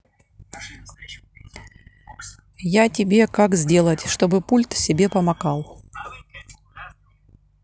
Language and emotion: Russian, neutral